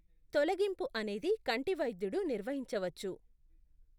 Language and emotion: Telugu, neutral